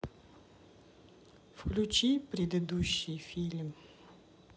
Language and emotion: Russian, neutral